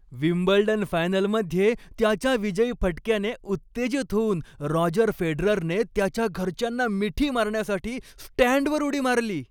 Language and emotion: Marathi, happy